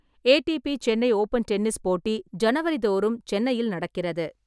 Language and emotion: Tamil, neutral